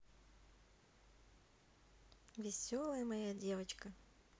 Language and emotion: Russian, neutral